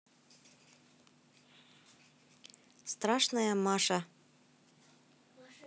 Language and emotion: Russian, neutral